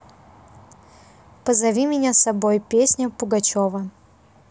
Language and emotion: Russian, neutral